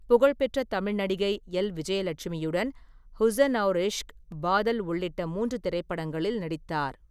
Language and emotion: Tamil, neutral